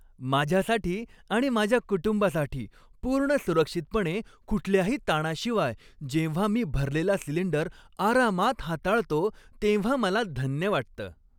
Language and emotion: Marathi, happy